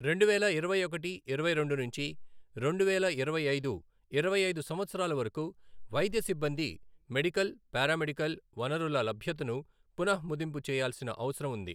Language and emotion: Telugu, neutral